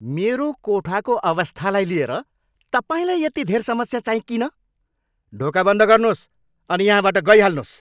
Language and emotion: Nepali, angry